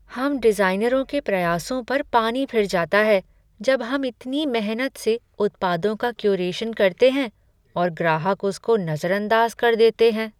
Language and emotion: Hindi, sad